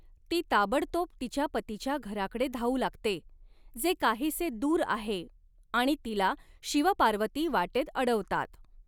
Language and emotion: Marathi, neutral